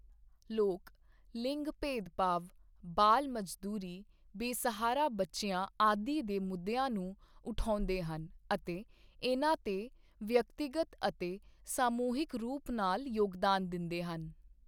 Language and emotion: Punjabi, neutral